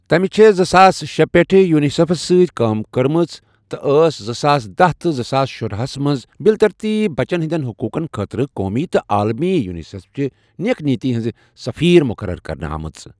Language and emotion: Kashmiri, neutral